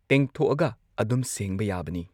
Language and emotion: Manipuri, neutral